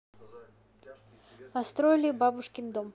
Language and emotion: Russian, neutral